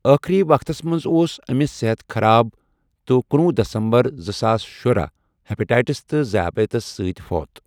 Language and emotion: Kashmiri, neutral